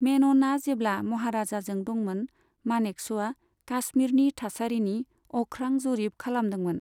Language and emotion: Bodo, neutral